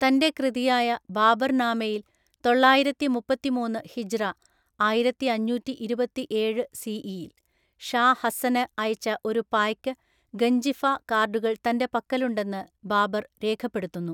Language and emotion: Malayalam, neutral